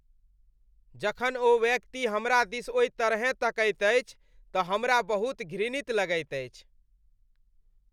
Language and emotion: Maithili, disgusted